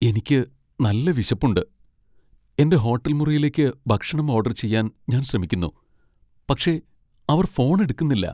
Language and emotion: Malayalam, sad